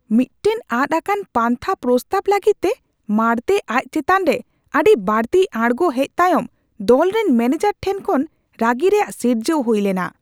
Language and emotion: Santali, angry